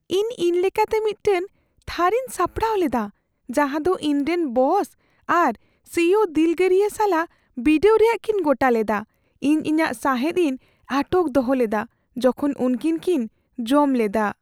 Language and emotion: Santali, fearful